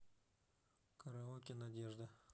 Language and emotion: Russian, neutral